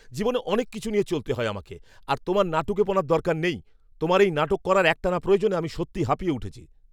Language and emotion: Bengali, angry